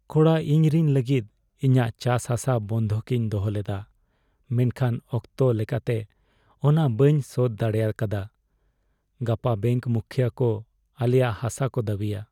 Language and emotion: Santali, sad